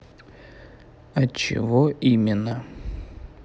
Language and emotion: Russian, neutral